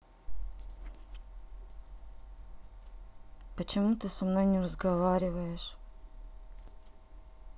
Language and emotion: Russian, sad